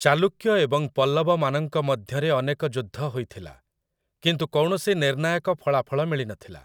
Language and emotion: Odia, neutral